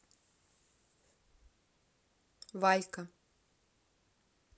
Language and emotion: Russian, neutral